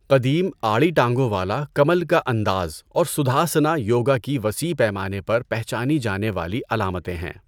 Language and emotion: Urdu, neutral